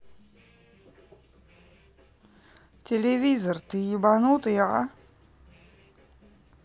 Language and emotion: Russian, neutral